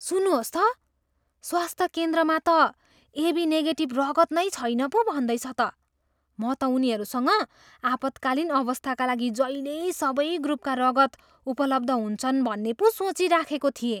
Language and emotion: Nepali, surprised